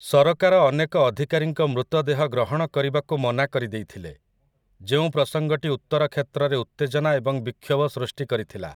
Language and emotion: Odia, neutral